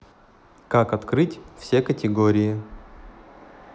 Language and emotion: Russian, neutral